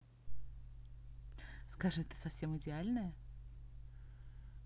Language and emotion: Russian, positive